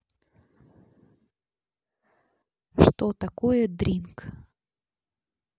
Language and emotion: Russian, neutral